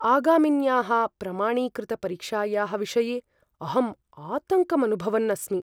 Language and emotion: Sanskrit, fearful